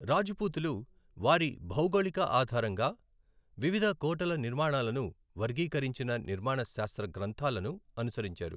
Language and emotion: Telugu, neutral